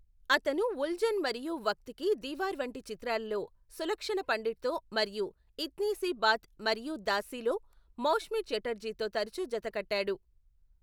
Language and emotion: Telugu, neutral